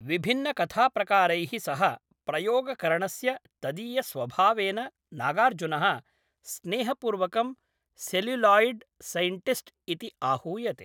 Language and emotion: Sanskrit, neutral